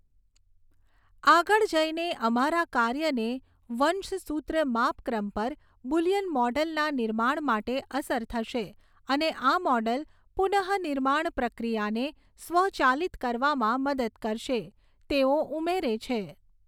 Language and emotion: Gujarati, neutral